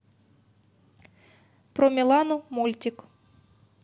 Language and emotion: Russian, neutral